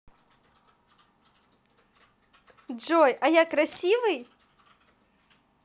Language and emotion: Russian, positive